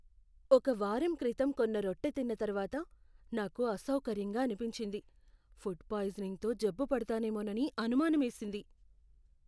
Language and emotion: Telugu, fearful